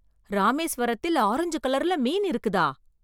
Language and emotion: Tamil, surprised